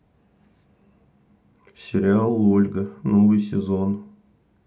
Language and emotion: Russian, neutral